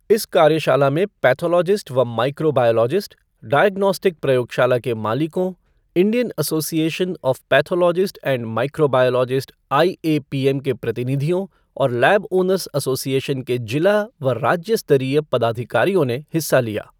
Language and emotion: Hindi, neutral